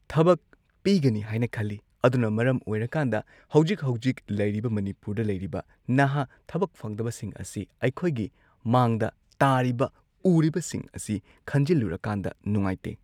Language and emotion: Manipuri, neutral